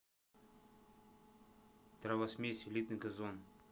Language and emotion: Russian, neutral